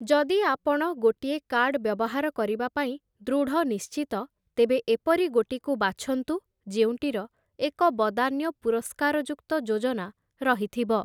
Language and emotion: Odia, neutral